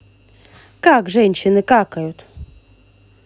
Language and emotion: Russian, positive